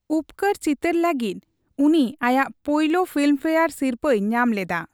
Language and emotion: Santali, neutral